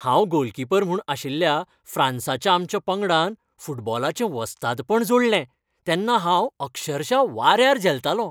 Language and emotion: Goan Konkani, happy